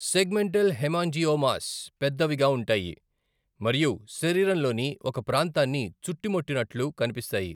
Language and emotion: Telugu, neutral